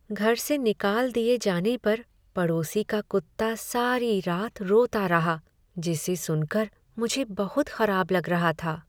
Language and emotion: Hindi, sad